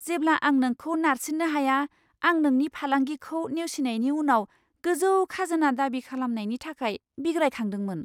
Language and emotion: Bodo, surprised